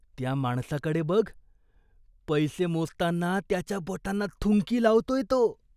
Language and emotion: Marathi, disgusted